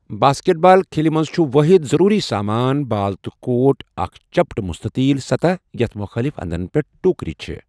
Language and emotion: Kashmiri, neutral